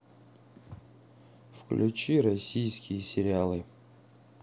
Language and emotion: Russian, neutral